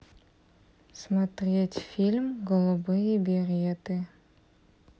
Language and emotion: Russian, neutral